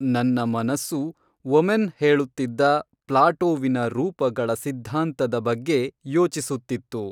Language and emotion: Kannada, neutral